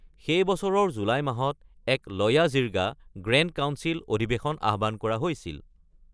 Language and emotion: Assamese, neutral